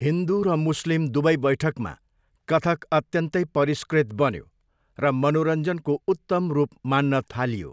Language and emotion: Nepali, neutral